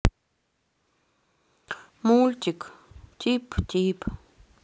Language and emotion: Russian, sad